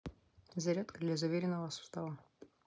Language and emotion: Russian, neutral